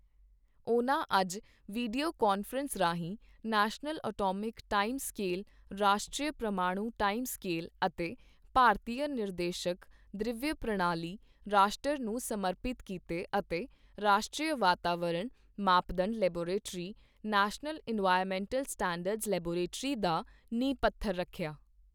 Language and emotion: Punjabi, neutral